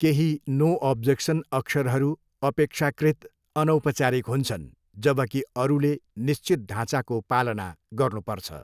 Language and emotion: Nepali, neutral